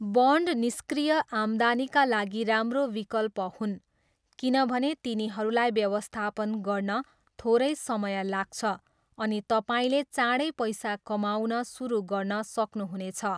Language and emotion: Nepali, neutral